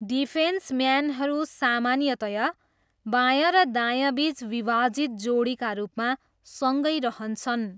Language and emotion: Nepali, neutral